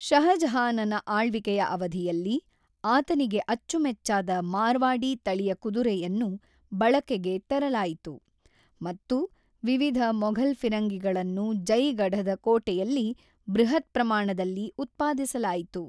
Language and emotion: Kannada, neutral